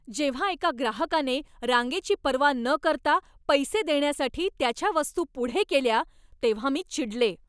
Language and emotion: Marathi, angry